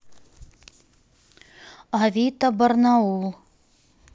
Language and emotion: Russian, neutral